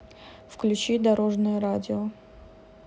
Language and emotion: Russian, neutral